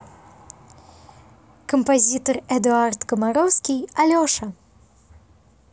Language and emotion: Russian, positive